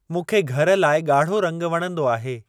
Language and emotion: Sindhi, neutral